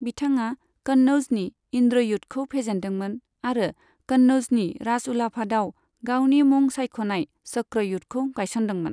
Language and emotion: Bodo, neutral